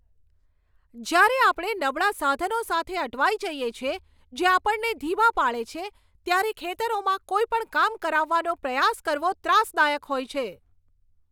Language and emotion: Gujarati, angry